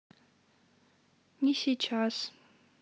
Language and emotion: Russian, sad